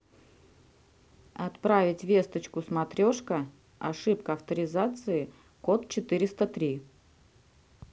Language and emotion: Russian, neutral